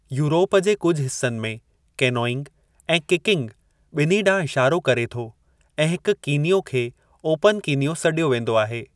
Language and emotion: Sindhi, neutral